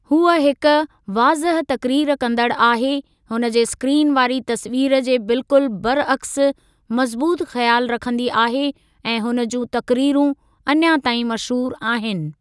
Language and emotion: Sindhi, neutral